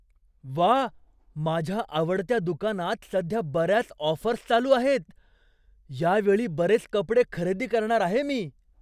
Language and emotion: Marathi, surprised